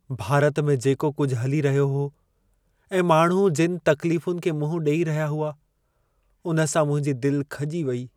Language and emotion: Sindhi, sad